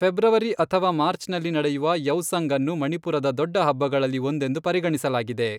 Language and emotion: Kannada, neutral